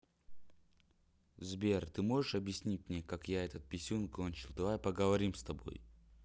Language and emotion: Russian, neutral